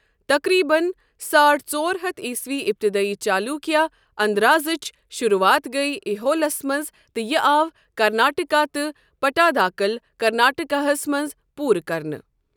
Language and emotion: Kashmiri, neutral